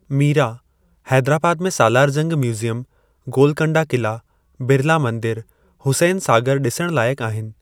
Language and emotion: Sindhi, neutral